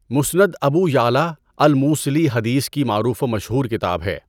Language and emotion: Urdu, neutral